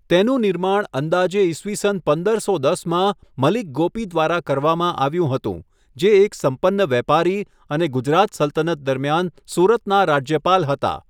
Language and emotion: Gujarati, neutral